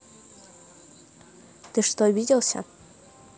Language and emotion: Russian, neutral